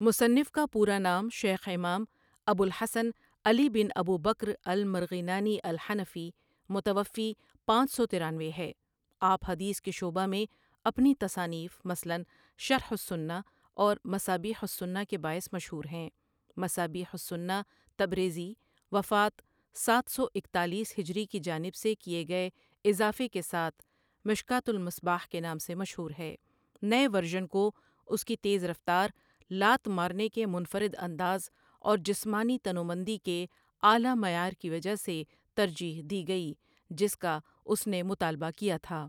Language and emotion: Urdu, neutral